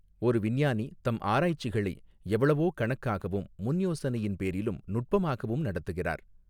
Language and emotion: Tamil, neutral